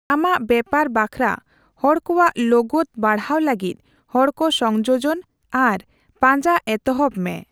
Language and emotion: Santali, neutral